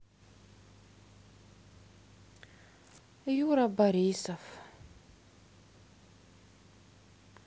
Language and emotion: Russian, sad